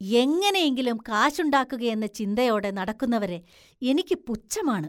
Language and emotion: Malayalam, disgusted